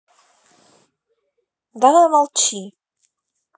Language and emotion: Russian, neutral